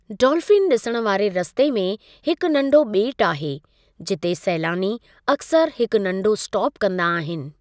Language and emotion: Sindhi, neutral